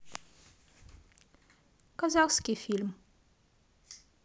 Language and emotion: Russian, neutral